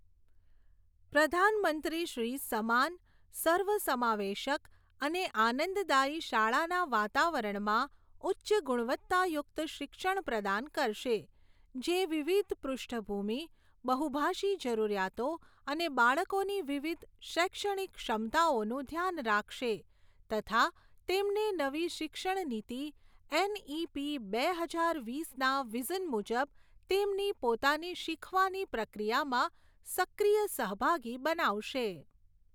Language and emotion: Gujarati, neutral